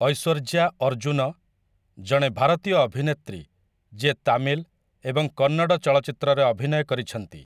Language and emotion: Odia, neutral